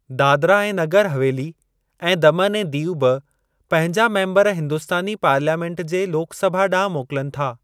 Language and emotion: Sindhi, neutral